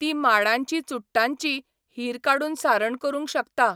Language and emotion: Goan Konkani, neutral